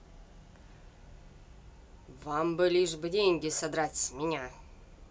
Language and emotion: Russian, angry